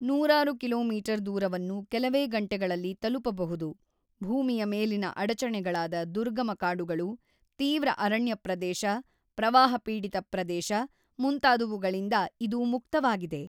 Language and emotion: Kannada, neutral